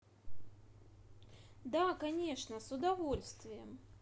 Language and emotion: Russian, positive